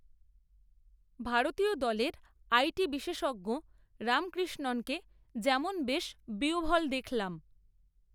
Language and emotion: Bengali, neutral